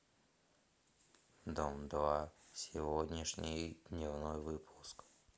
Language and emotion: Russian, neutral